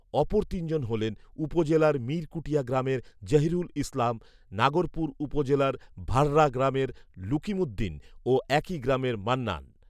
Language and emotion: Bengali, neutral